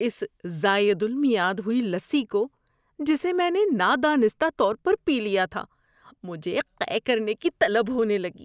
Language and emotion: Urdu, disgusted